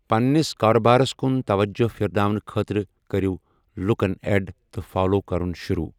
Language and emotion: Kashmiri, neutral